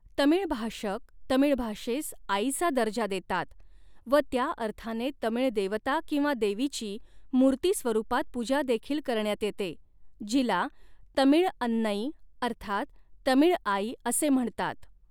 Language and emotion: Marathi, neutral